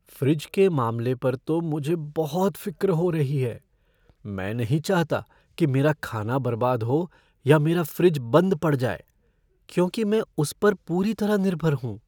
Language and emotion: Hindi, fearful